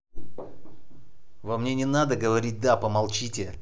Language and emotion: Russian, angry